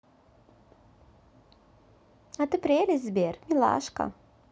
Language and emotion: Russian, positive